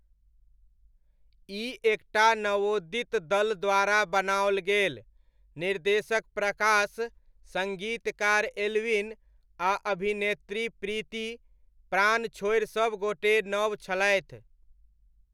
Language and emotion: Maithili, neutral